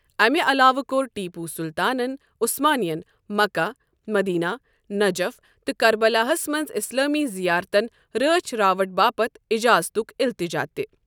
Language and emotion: Kashmiri, neutral